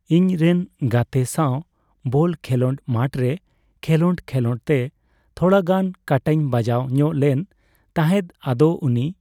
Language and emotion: Santali, neutral